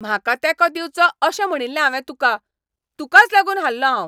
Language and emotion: Goan Konkani, angry